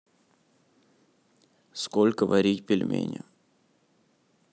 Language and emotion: Russian, neutral